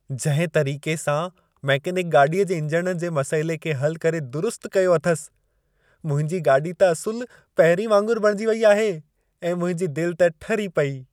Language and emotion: Sindhi, happy